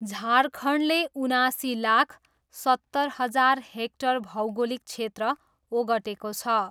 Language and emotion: Nepali, neutral